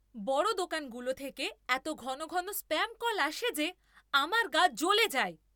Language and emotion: Bengali, angry